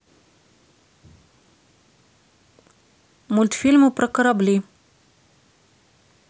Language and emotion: Russian, neutral